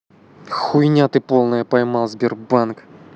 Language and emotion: Russian, angry